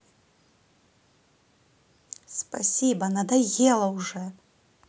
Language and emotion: Russian, angry